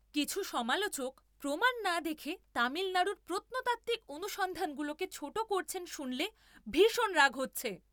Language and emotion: Bengali, angry